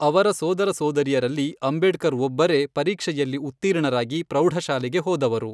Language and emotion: Kannada, neutral